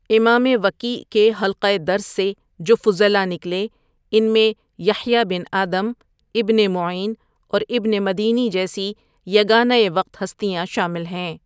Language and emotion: Urdu, neutral